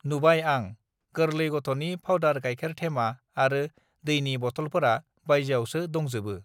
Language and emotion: Bodo, neutral